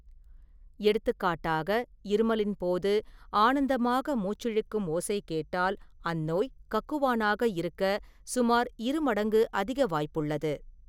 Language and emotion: Tamil, neutral